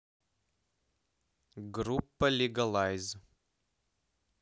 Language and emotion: Russian, neutral